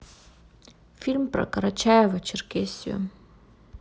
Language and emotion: Russian, neutral